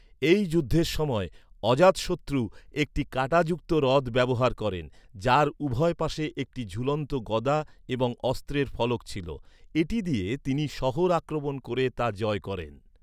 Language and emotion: Bengali, neutral